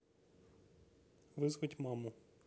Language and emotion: Russian, neutral